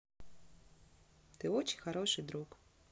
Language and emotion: Russian, positive